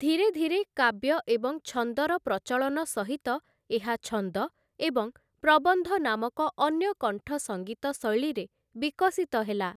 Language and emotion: Odia, neutral